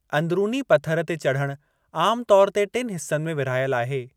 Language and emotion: Sindhi, neutral